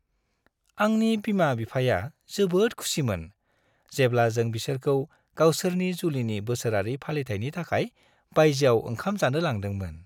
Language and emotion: Bodo, happy